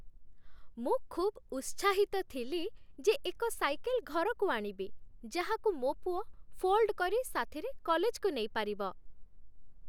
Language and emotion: Odia, happy